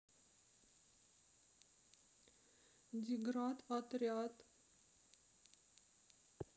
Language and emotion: Russian, sad